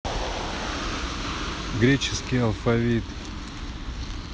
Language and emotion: Russian, neutral